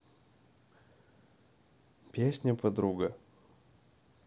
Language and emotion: Russian, neutral